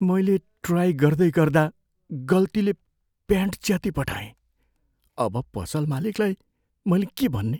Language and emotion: Nepali, fearful